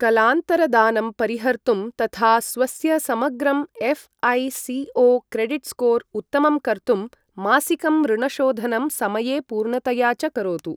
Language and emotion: Sanskrit, neutral